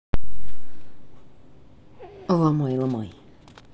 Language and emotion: Russian, neutral